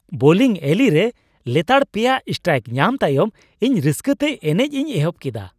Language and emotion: Santali, happy